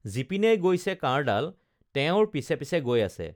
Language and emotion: Assamese, neutral